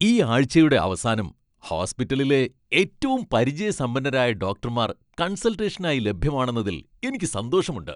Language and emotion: Malayalam, happy